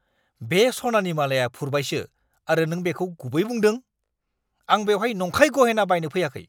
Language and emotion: Bodo, angry